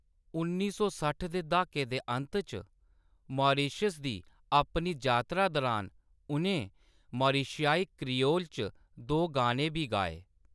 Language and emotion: Dogri, neutral